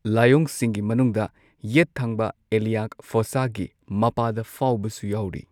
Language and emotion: Manipuri, neutral